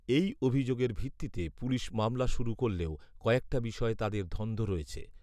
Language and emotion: Bengali, neutral